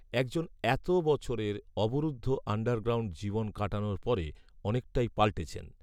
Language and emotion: Bengali, neutral